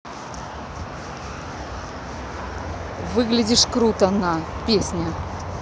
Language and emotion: Russian, neutral